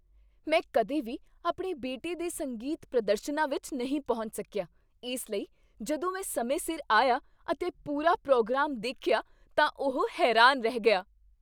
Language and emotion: Punjabi, surprised